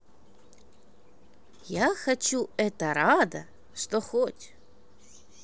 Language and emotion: Russian, positive